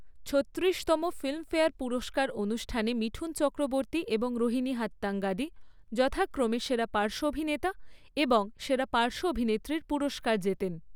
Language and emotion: Bengali, neutral